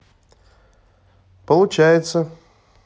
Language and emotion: Russian, neutral